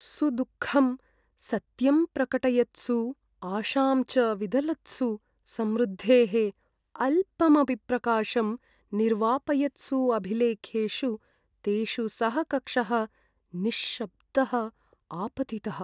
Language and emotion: Sanskrit, sad